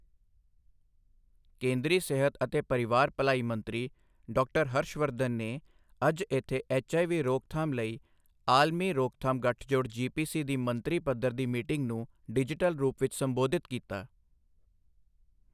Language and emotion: Punjabi, neutral